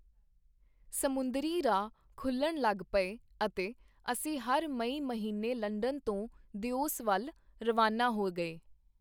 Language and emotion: Punjabi, neutral